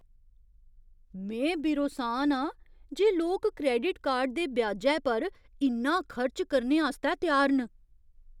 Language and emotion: Dogri, surprised